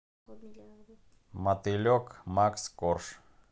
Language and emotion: Russian, neutral